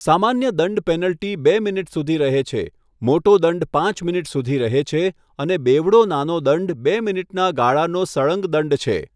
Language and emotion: Gujarati, neutral